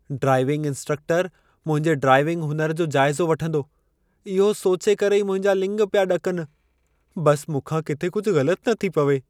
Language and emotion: Sindhi, fearful